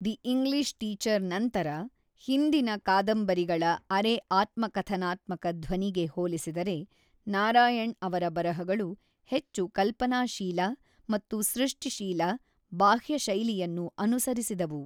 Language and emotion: Kannada, neutral